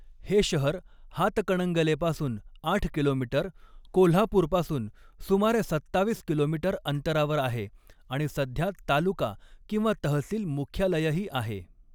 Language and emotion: Marathi, neutral